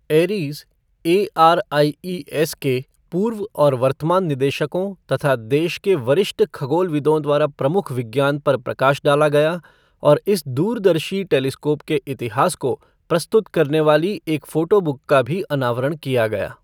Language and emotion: Hindi, neutral